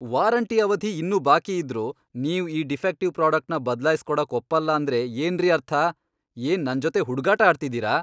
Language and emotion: Kannada, angry